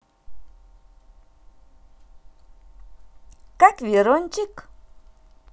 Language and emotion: Russian, positive